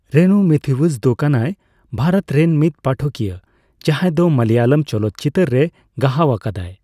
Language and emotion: Santali, neutral